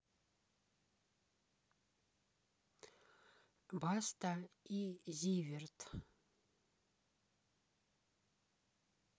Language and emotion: Russian, neutral